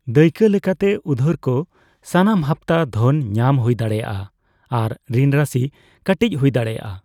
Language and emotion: Santali, neutral